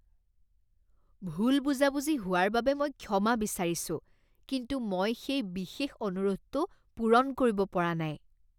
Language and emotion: Assamese, disgusted